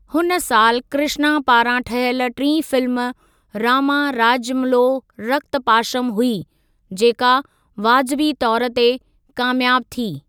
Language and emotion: Sindhi, neutral